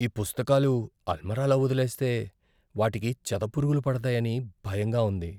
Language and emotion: Telugu, fearful